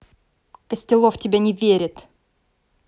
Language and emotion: Russian, angry